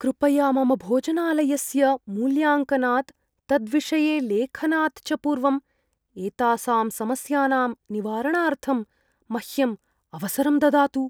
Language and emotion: Sanskrit, fearful